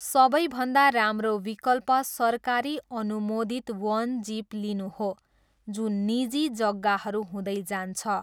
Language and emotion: Nepali, neutral